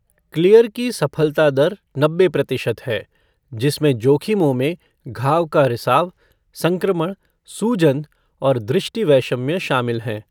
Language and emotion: Hindi, neutral